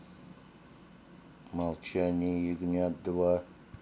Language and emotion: Russian, angry